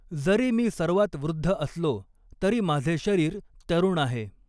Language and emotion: Marathi, neutral